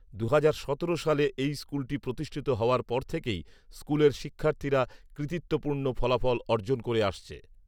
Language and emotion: Bengali, neutral